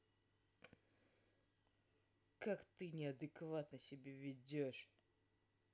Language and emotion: Russian, angry